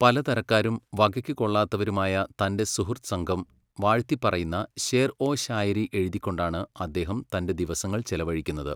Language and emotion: Malayalam, neutral